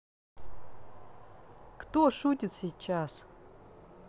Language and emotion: Russian, neutral